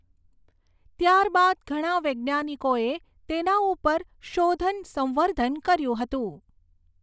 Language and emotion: Gujarati, neutral